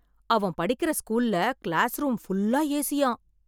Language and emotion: Tamil, surprised